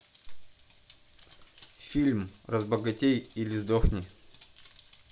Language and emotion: Russian, neutral